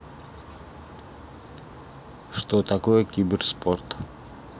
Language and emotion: Russian, neutral